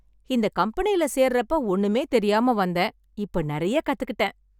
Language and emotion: Tamil, happy